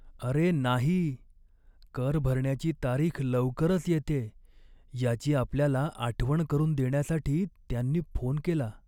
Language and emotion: Marathi, sad